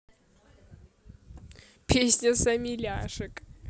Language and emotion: Russian, positive